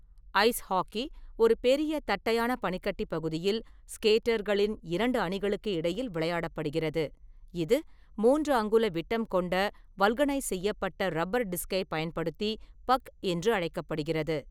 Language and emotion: Tamil, neutral